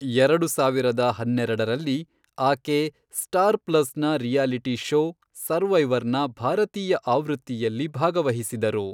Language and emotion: Kannada, neutral